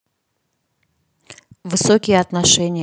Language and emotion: Russian, neutral